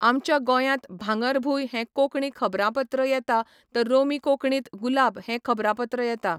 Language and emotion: Goan Konkani, neutral